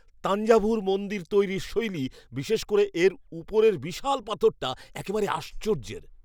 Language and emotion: Bengali, surprised